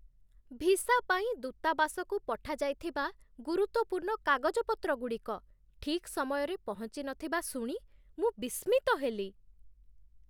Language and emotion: Odia, surprised